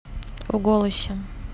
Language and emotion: Russian, neutral